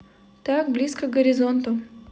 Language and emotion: Russian, neutral